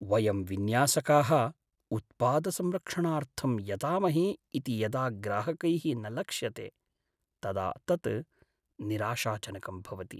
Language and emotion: Sanskrit, sad